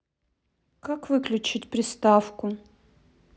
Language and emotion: Russian, neutral